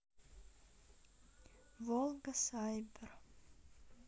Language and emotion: Russian, neutral